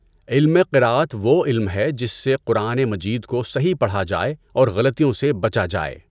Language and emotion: Urdu, neutral